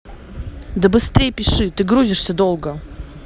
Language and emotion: Russian, angry